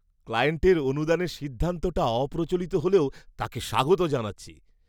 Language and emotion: Bengali, surprised